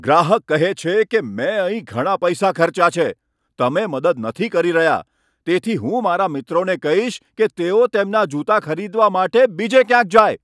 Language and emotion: Gujarati, angry